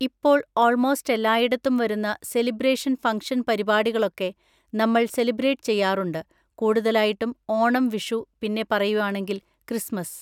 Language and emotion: Malayalam, neutral